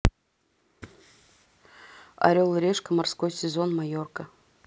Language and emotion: Russian, neutral